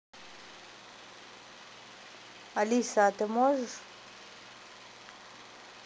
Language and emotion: Russian, neutral